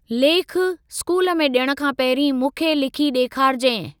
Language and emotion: Sindhi, neutral